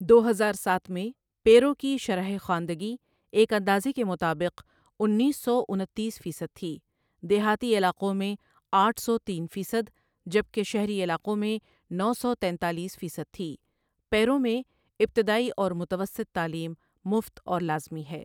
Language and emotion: Urdu, neutral